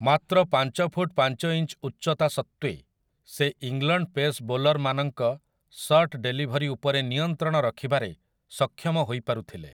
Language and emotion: Odia, neutral